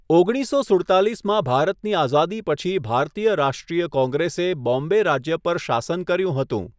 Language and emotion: Gujarati, neutral